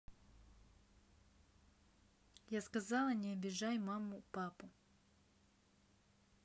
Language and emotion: Russian, angry